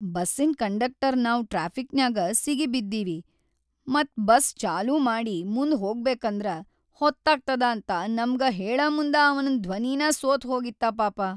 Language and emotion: Kannada, sad